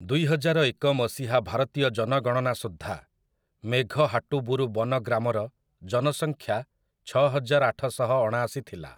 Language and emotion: Odia, neutral